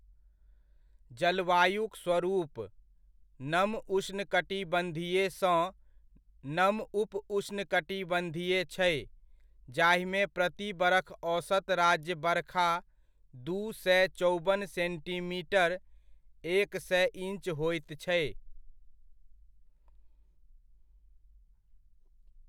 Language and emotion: Maithili, neutral